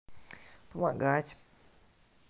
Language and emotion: Russian, neutral